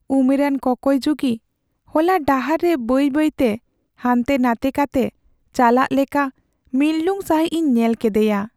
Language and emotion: Santali, sad